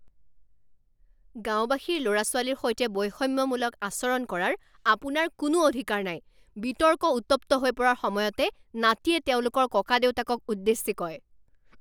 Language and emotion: Assamese, angry